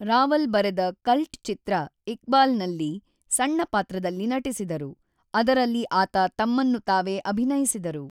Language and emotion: Kannada, neutral